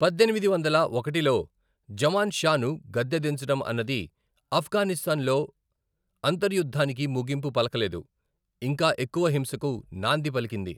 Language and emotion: Telugu, neutral